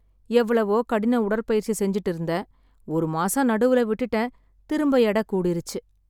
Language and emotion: Tamil, sad